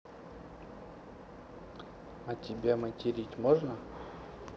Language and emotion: Russian, neutral